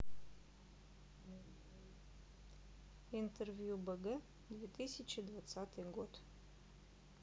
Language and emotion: Russian, neutral